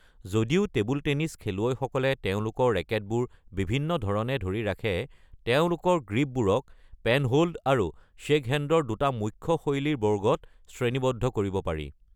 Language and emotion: Assamese, neutral